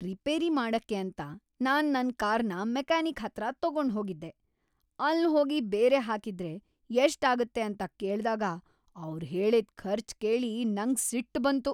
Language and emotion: Kannada, angry